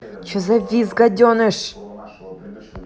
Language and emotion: Russian, angry